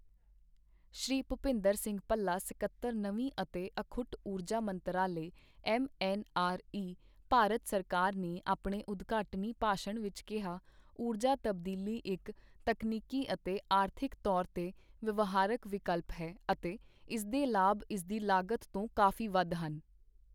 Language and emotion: Punjabi, neutral